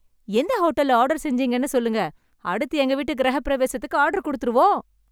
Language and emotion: Tamil, happy